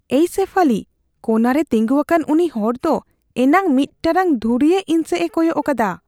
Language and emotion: Santali, fearful